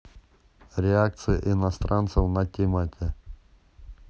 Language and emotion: Russian, neutral